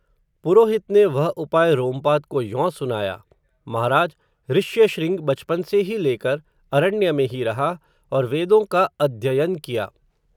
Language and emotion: Hindi, neutral